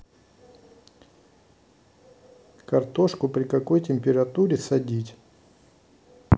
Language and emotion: Russian, neutral